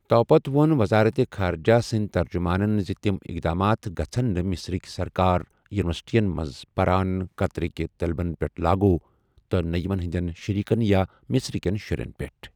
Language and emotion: Kashmiri, neutral